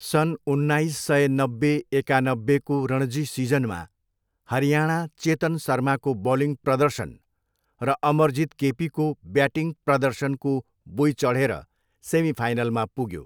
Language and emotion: Nepali, neutral